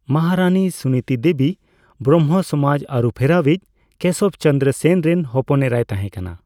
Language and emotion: Santali, neutral